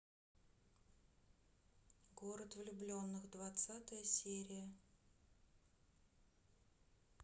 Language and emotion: Russian, sad